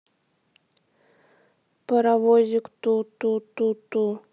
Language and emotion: Russian, sad